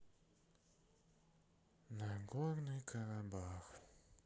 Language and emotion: Russian, sad